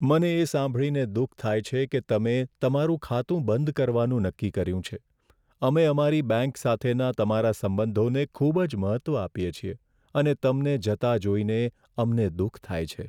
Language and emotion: Gujarati, sad